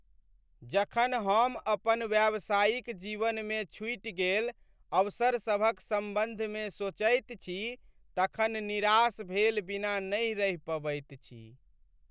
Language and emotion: Maithili, sad